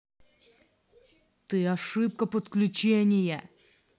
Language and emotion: Russian, angry